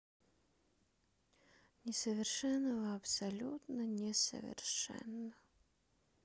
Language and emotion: Russian, sad